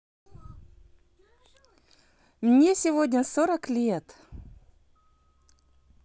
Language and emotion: Russian, positive